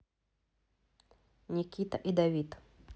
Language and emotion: Russian, neutral